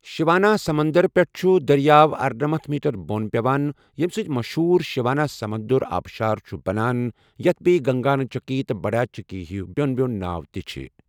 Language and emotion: Kashmiri, neutral